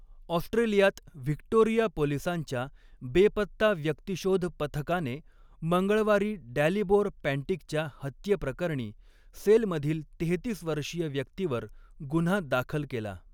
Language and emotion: Marathi, neutral